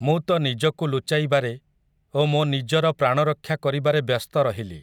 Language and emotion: Odia, neutral